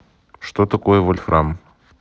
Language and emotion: Russian, neutral